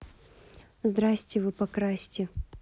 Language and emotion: Russian, neutral